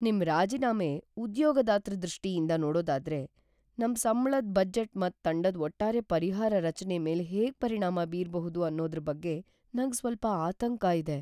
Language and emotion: Kannada, fearful